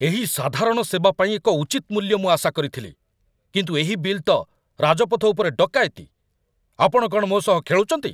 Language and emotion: Odia, angry